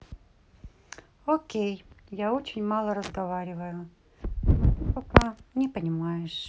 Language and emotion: Russian, neutral